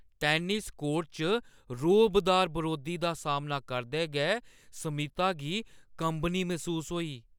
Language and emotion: Dogri, fearful